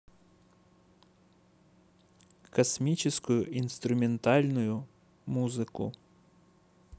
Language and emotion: Russian, neutral